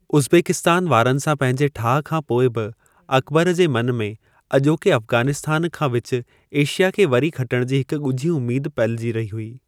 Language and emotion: Sindhi, neutral